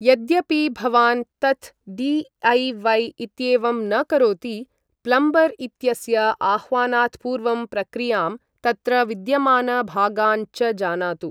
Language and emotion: Sanskrit, neutral